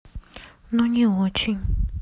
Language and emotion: Russian, sad